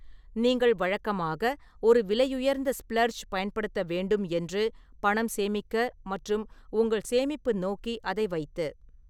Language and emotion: Tamil, neutral